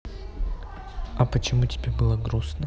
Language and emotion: Russian, neutral